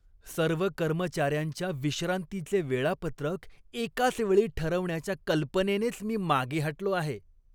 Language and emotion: Marathi, disgusted